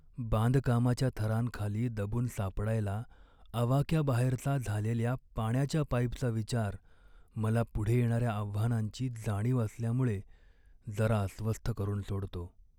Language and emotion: Marathi, sad